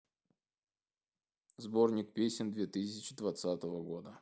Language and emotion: Russian, neutral